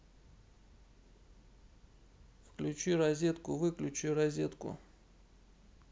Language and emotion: Russian, neutral